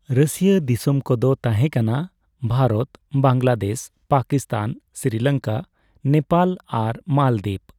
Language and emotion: Santali, neutral